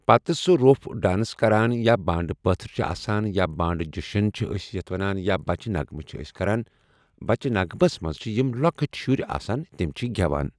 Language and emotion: Kashmiri, neutral